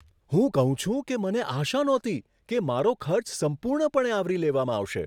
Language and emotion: Gujarati, surprised